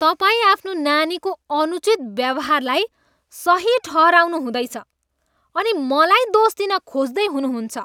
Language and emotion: Nepali, disgusted